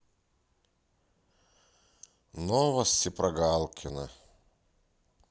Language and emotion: Russian, sad